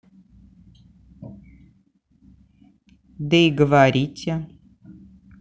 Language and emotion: Russian, neutral